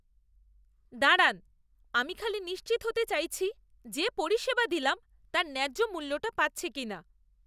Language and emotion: Bengali, disgusted